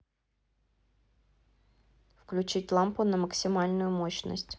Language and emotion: Russian, neutral